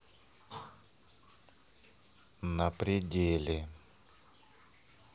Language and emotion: Russian, neutral